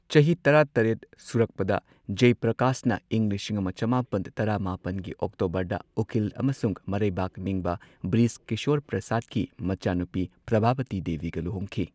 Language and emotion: Manipuri, neutral